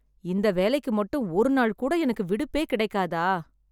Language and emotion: Tamil, sad